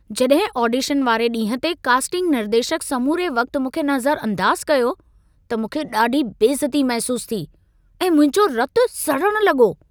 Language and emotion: Sindhi, angry